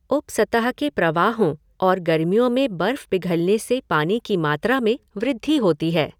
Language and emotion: Hindi, neutral